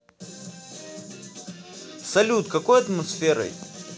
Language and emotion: Russian, positive